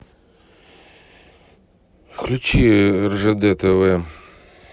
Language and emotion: Russian, neutral